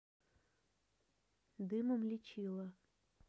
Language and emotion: Russian, neutral